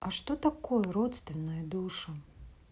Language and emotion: Russian, neutral